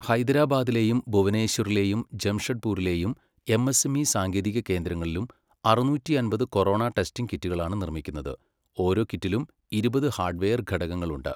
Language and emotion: Malayalam, neutral